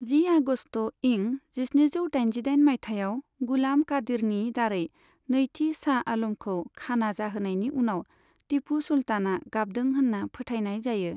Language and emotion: Bodo, neutral